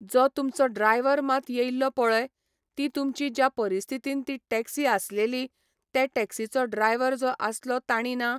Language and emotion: Goan Konkani, neutral